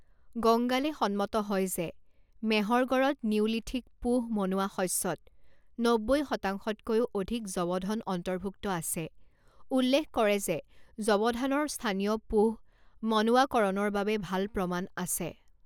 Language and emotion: Assamese, neutral